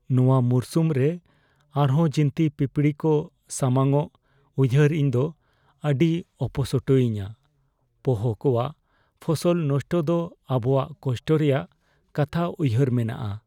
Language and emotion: Santali, fearful